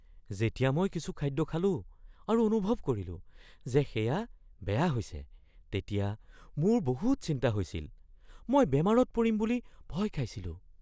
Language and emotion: Assamese, fearful